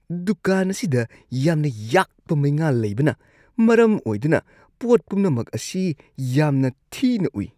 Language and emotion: Manipuri, disgusted